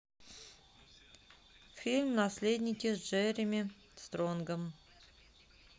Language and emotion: Russian, neutral